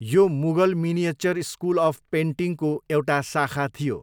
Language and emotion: Nepali, neutral